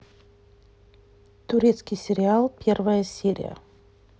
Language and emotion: Russian, neutral